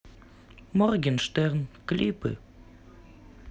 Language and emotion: Russian, neutral